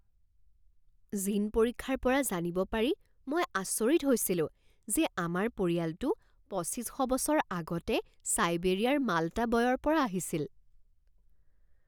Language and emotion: Assamese, surprised